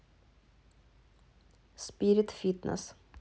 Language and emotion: Russian, neutral